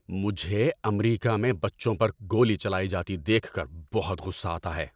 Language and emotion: Urdu, angry